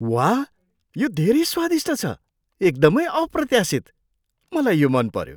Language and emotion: Nepali, surprised